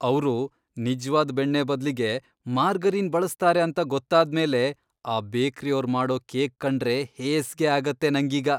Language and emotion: Kannada, disgusted